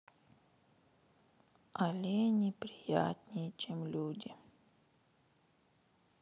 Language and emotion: Russian, sad